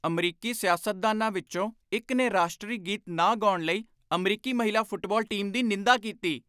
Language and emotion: Punjabi, angry